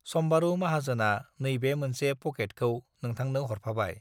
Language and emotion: Bodo, neutral